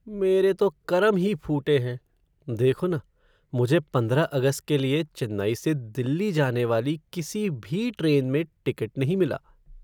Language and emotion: Hindi, sad